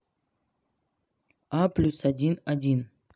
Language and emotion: Russian, neutral